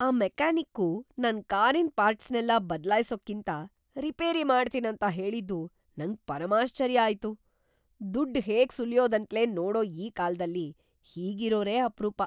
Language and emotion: Kannada, surprised